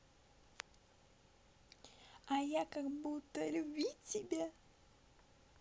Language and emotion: Russian, positive